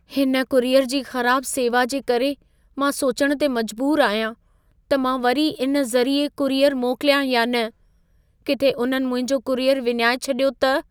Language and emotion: Sindhi, fearful